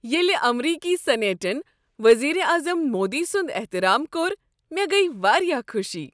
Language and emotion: Kashmiri, happy